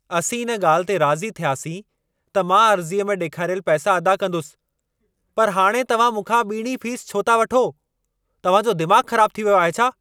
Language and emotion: Sindhi, angry